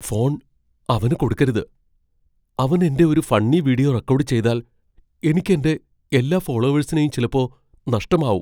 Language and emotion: Malayalam, fearful